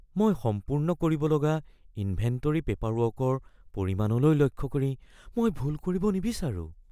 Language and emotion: Assamese, fearful